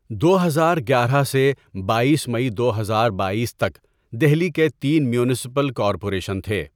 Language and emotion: Urdu, neutral